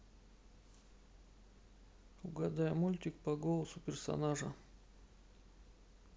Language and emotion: Russian, neutral